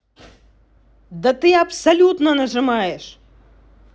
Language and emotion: Russian, angry